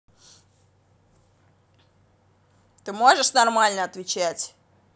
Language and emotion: Russian, angry